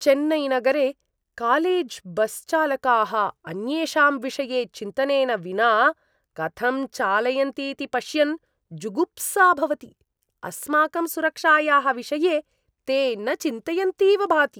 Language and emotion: Sanskrit, disgusted